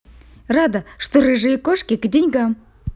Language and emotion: Russian, positive